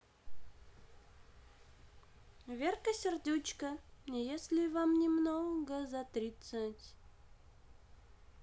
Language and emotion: Russian, positive